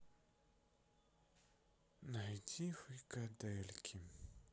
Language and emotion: Russian, sad